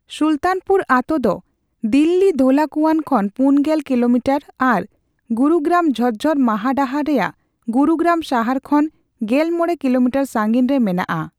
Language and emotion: Santali, neutral